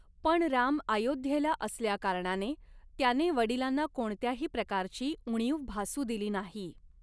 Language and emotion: Marathi, neutral